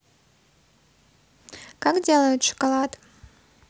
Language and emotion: Russian, neutral